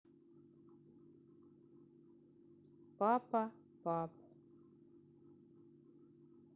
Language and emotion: Russian, neutral